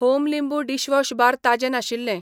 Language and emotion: Goan Konkani, neutral